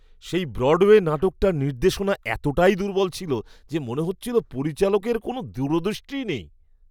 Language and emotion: Bengali, disgusted